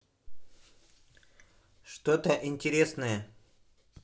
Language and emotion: Russian, neutral